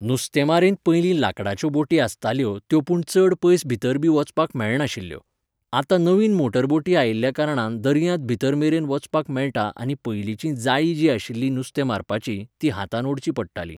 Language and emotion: Goan Konkani, neutral